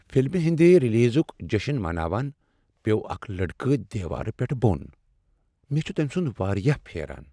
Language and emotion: Kashmiri, sad